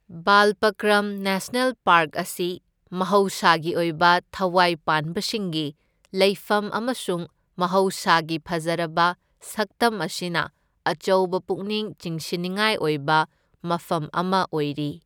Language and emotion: Manipuri, neutral